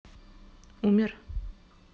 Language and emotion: Russian, sad